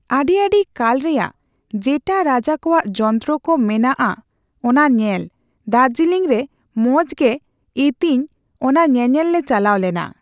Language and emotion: Santali, neutral